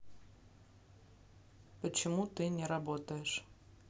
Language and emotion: Russian, neutral